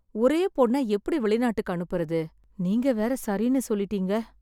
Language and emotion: Tamil, sad